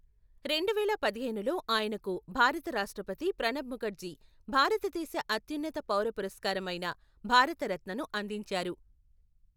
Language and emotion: Telugu, neutral